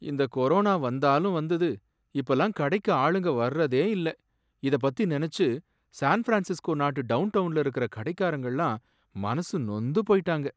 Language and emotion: Tamil, sad